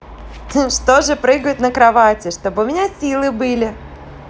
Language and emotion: Russian, positive